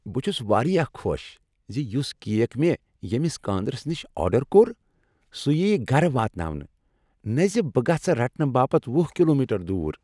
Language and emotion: Kashmiri, happy